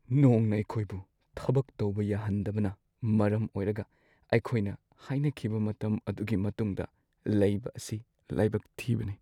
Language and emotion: Manipuri, sad